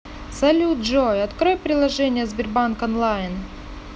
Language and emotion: Russian, neutral